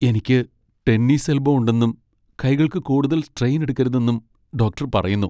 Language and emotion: Malayalam, sad